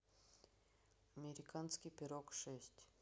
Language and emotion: Russian, neutral